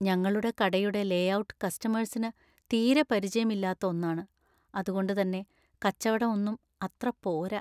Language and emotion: Malayalam, sad